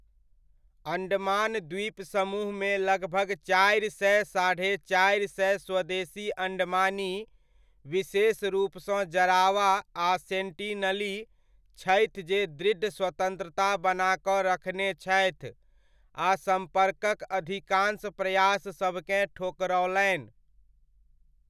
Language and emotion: Maithili, neutral